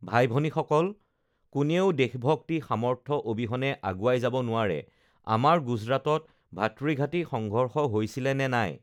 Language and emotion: Assamese, neutral